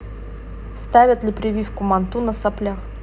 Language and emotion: Russian, neutral